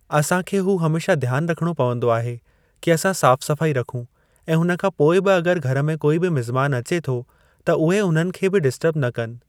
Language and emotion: Sindhi, neutral